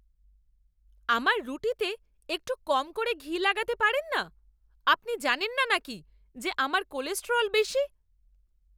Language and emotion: Bengali, angry